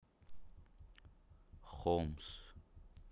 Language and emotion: Russian, neutral